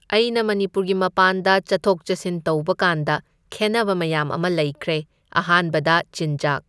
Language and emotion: Manipuri, neutral